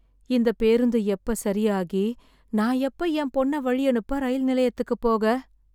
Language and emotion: Tamil, sad